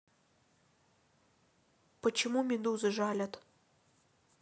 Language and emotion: Russian, neutral